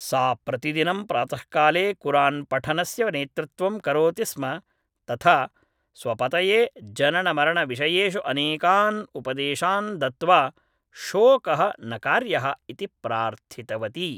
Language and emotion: Sanskrit, neutral